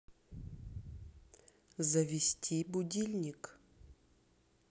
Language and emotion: Russian, neutral